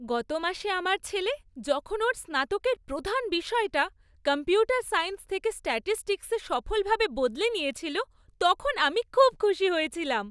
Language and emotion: Bengali, happy